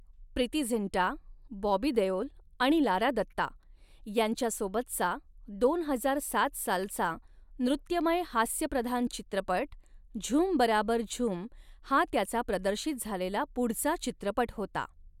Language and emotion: Marathi, neutral